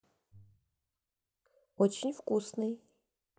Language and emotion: Russian, neutral